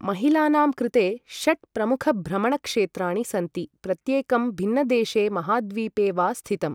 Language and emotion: Sanskrit, neutral